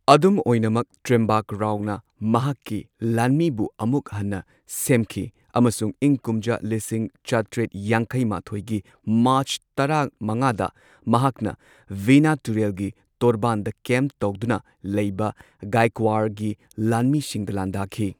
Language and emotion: Manipuri, neutral